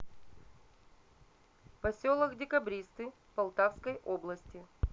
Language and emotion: Russian, neutral